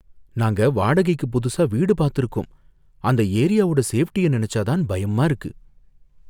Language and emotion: Tamil, fearful